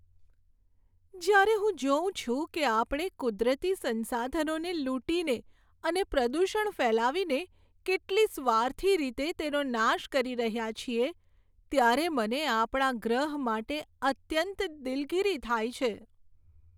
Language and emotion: Gujarati, sad